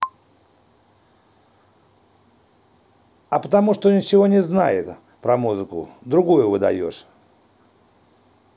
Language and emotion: Russian, angry